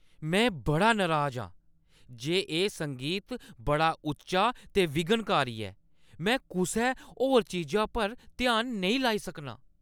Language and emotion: Dogri, angry